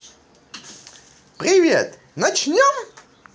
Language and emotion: Russian, positive